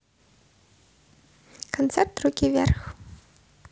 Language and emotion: Russian, neutral